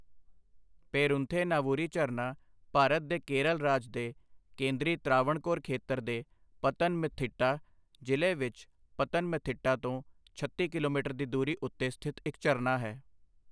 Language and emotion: Punjabi, neutral